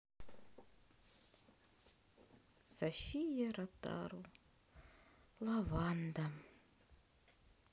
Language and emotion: Russian, sad